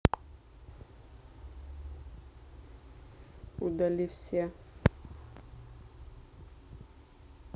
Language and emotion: Russian, neutral